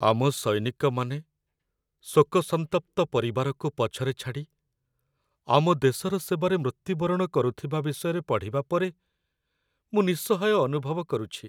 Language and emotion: Odia, sad